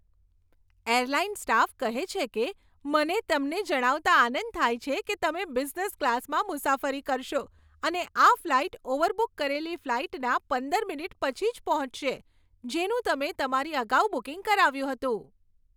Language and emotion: Gujarati, happy